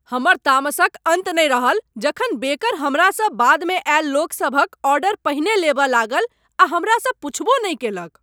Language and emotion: Maithili, angry